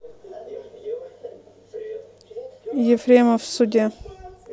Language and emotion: Russian, neutral